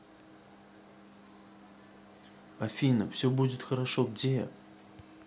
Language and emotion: Russian, sad